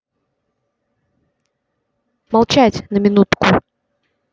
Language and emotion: Russian, neutral